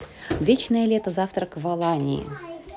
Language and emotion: Russian, neutral